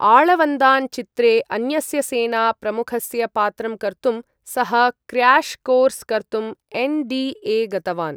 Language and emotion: Sanskrit, neutral